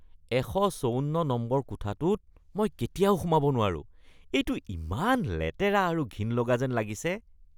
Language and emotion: Assamese, disgusted